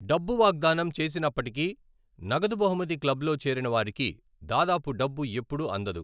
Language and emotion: Telugu, neutral